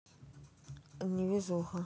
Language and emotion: Russian, sad